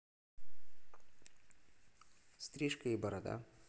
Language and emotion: Russian, neutral